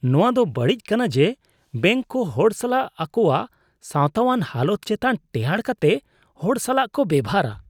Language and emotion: Santali, disgusted